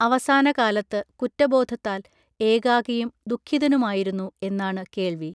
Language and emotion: Malayalam, neutral